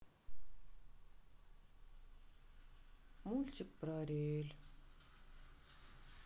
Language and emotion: Russian, sad